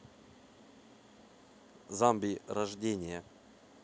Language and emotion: Russian, neutral